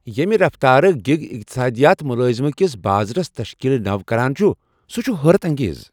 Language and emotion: Kashmiri, surprised